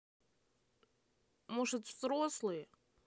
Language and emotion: Russian, neutral